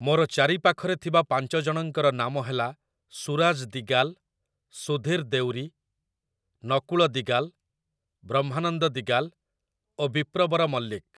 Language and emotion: Odia, neutral